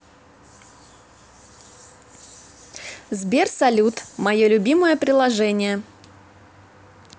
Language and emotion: Russian, positive